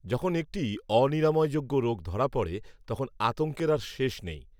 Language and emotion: Bengali, neutral